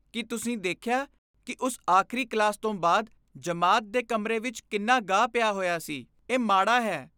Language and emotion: Punjabi, disgusted